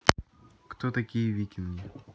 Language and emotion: Russian, neutral